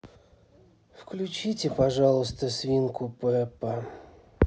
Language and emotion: Russian, sad